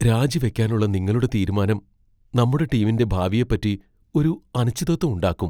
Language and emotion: Malayalam, fearful